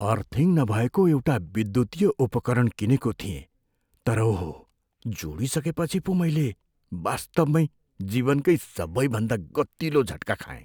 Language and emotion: Nepali, fearful